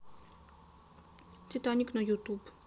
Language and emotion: Russian, neutral